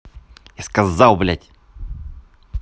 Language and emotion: Russian, angry